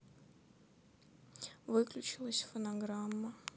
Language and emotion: Russian, sad